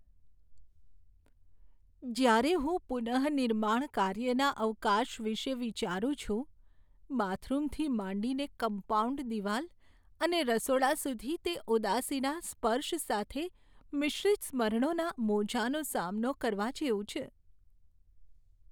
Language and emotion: Gujarati, sad